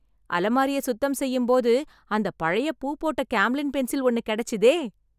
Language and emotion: Tamil, happy